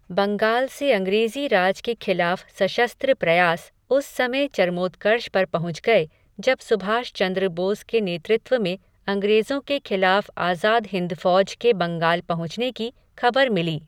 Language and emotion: Hindi, neutral